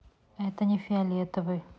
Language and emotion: Russian, neutral